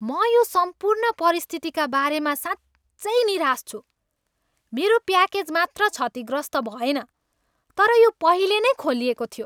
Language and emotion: Nepali, angry